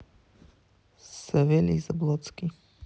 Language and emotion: Russian, neutral